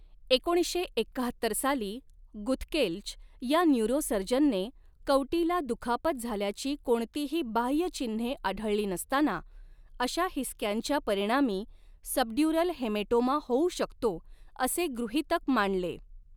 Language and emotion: Marathi, neutral